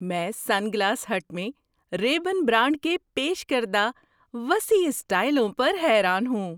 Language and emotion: Urdu, surprised